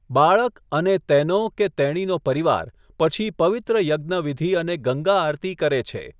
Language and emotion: Gujarati, neutral